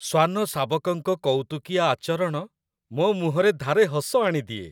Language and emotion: Odia, happy